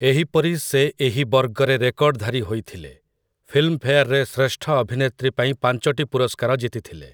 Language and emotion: Odia, neutral